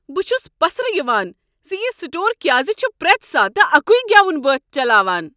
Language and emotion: Kashmiri, angry